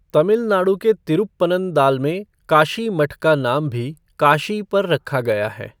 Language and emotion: Hindi, neutral